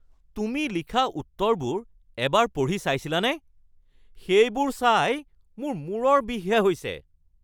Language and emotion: Assamese, angry